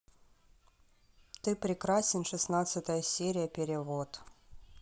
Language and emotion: Russian, neutral